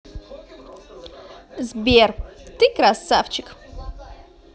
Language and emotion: Russian, positive